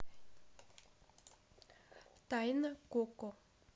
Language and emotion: Russian, neutral